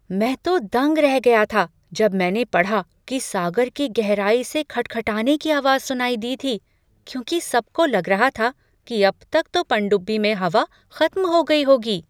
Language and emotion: Hindi, surprised